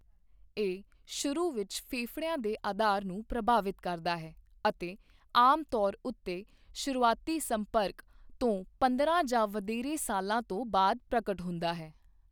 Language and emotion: Punjabi, neutral